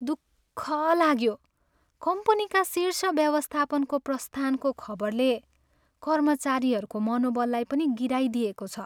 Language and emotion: Nepali, sad